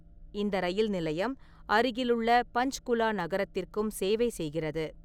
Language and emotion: Tamil, neutral